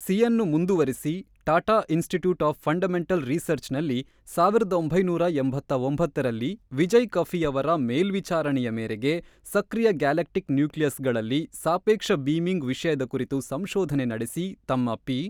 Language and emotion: Kannada, neutral